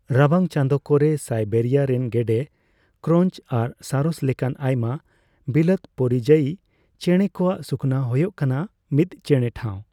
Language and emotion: Santali, neutral